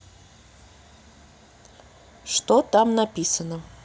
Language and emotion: Russian, neutral